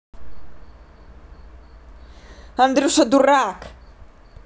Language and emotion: Russian, angry